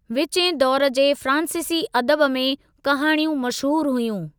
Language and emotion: Sindhi, neutral